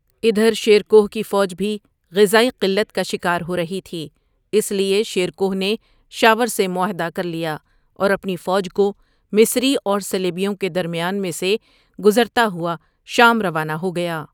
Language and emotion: Urdu, neutral